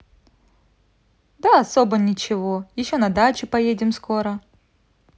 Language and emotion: Russian, positive